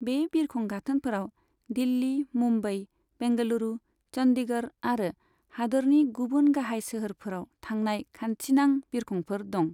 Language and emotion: Bodo, neutral